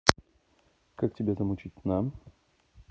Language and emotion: Russian, neutral